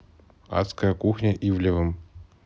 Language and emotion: Russian, neutral